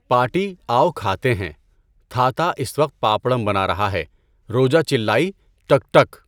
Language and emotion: Urdu, neutral